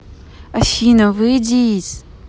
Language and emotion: Russian, neutral